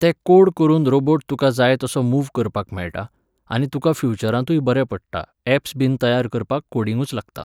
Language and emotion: Goan Konkani, neutral